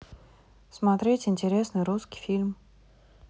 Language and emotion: Russian, neutral